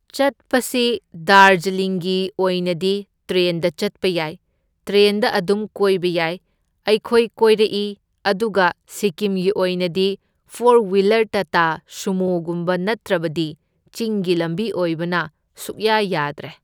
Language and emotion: Manipuri, neutral